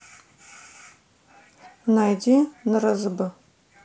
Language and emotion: Russian, neutral